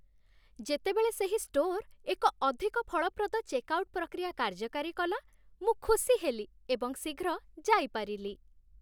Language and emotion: Odia, happy